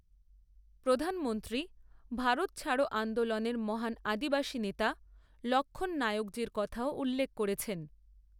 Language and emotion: Bengali, neutral